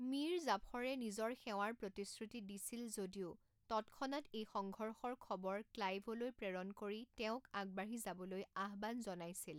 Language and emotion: Assamese, neutral